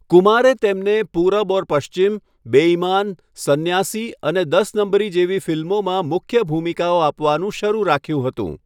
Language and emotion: Gujarati, neutral